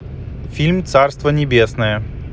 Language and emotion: Russian, neutral